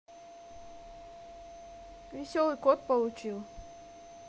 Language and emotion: Russian, neutral